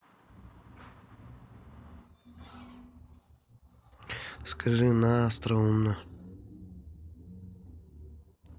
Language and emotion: Russian, neutral